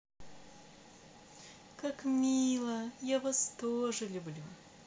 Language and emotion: Russian, positive